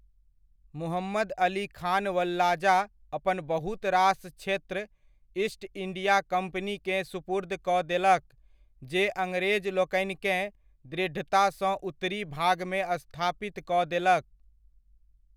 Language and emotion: Maithili, neutral